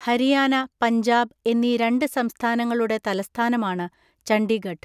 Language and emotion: Malayalam, neutral